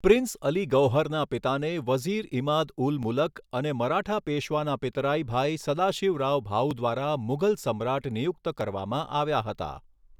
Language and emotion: Gujarati, neutral